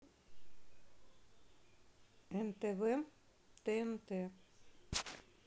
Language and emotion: Russian, neutral